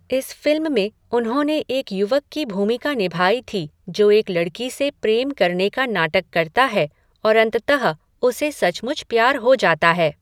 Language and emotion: Hindi, neutral